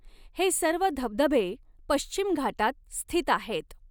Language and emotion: Marathi, neutral